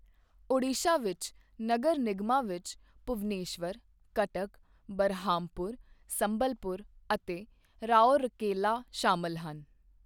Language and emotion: Punjabi, neutral